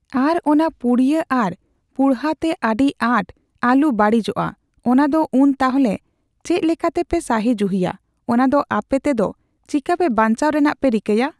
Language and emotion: Santali, neutral